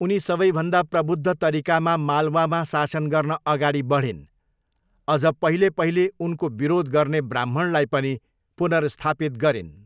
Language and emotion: Nepali, neutral